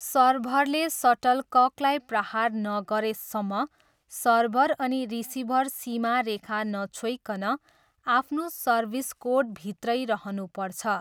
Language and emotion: Nepali, neutral